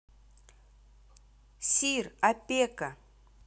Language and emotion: Russian, neutral